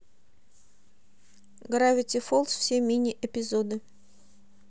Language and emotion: Russian, neutral